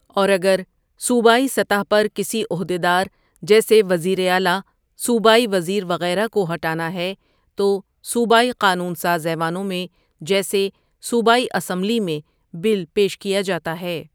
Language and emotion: Urdu, neutral